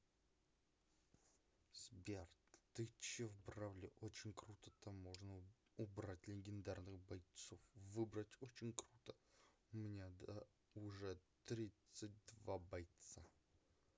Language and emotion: Russian, angry